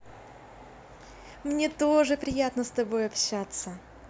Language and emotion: Russian, positive